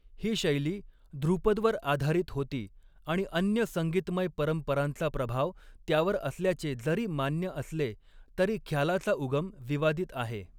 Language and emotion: Marathi, neutral